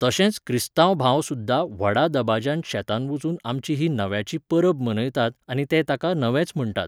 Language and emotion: Goan Konkani, neutral